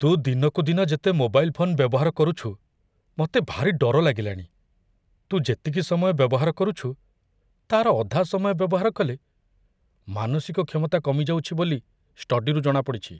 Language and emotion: Odia, fearful